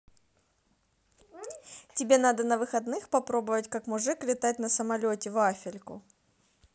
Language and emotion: Russian, neutral